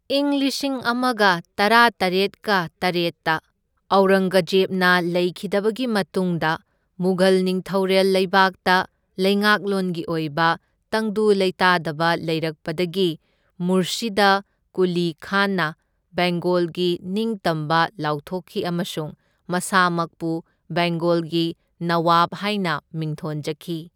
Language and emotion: Manipuri, neutral